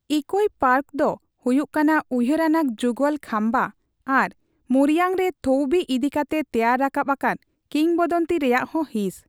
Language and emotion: Santali, neutral